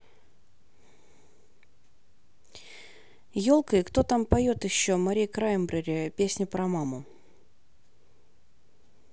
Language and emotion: Russian, neutral